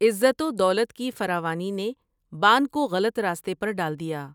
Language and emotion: Urdu, neutral